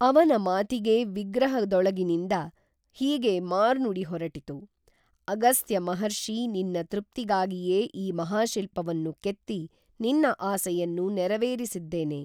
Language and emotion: Kannada, neutral